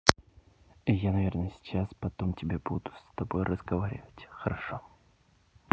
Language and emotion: Russian, neutral